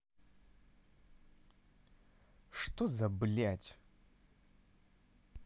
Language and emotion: Russian, angry